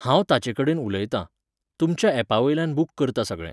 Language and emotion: Goan Konkani, neutral